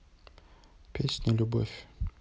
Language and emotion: Russian, neutral